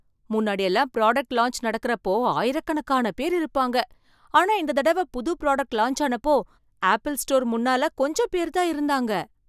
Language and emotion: Tamil, surprised